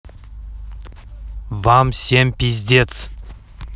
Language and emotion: Russian, neutral